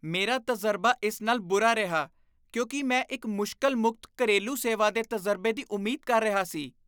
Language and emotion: Punjabi, disgusted